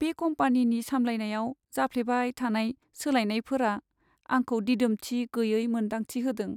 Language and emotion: Bodo, sad